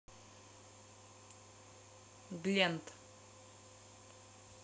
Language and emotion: Russian, neutral